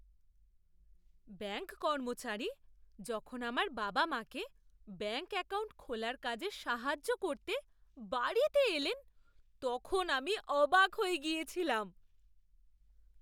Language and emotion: Bengali, surprised